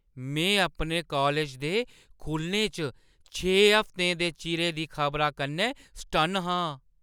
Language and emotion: Dogri, surprised